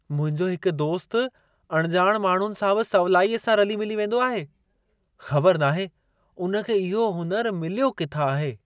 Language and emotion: Sindhi, surprised